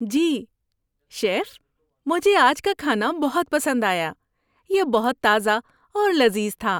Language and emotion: Urdu, happy